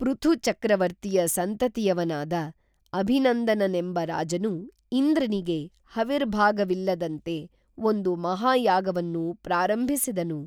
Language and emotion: Kannada, neutral